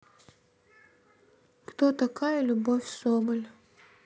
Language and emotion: Russian, neutral